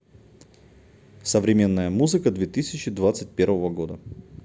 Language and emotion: Russian, neutral